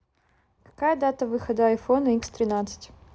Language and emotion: Russian, neutral